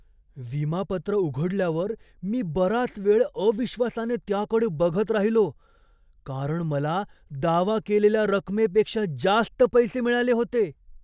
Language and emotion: Marathi, surprised